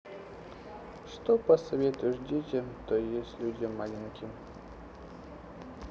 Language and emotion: Russian, sad